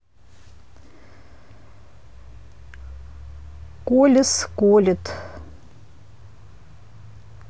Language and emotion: Russian, neutral